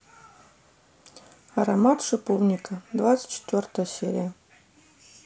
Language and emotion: Russian, neutral